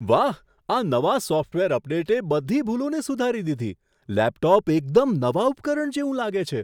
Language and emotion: Gujarati, surprised